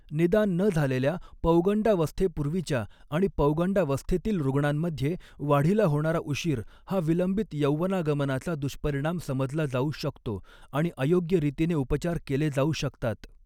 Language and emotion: Marathi, neutral